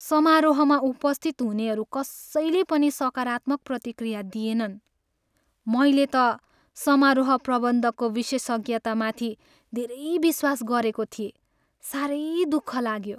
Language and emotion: Nepali, sad